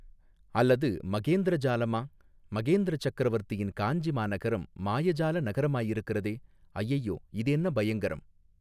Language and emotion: Tamil, neutral